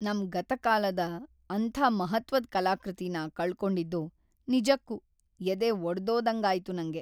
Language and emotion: Kannada, sad